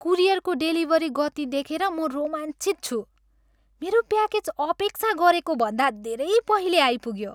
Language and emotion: Nepali, happy